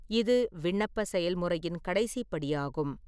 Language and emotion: Tamil, neutral